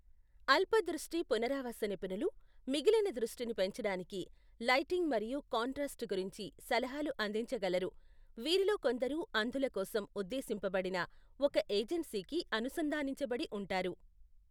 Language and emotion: Telugu, neutral